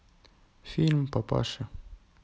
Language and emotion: Russian, sad